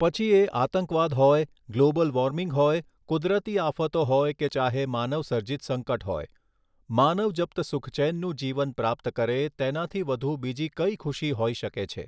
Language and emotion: Gujarati, neutral